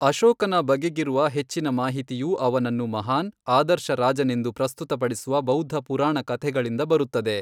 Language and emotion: Kannada, neutral